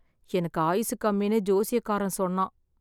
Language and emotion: Tamil, sad